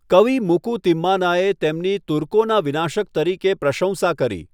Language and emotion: Gujarati, neutral